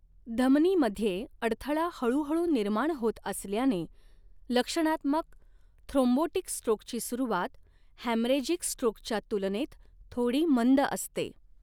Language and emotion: Marathi, neutral